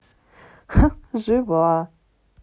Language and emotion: Russian, positive